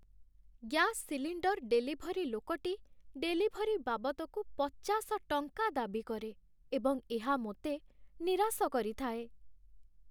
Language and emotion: Odia, sad